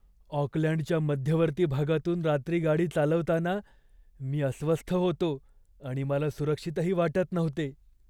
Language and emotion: Marathi, fearful